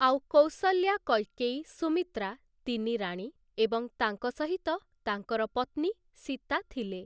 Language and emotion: Odia, neutral